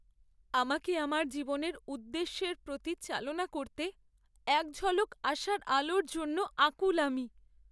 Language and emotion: Bengali, sad